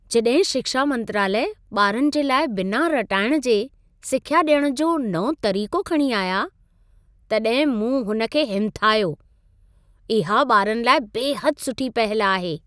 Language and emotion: Sindhi, happy